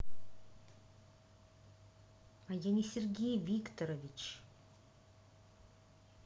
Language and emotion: Russian, angry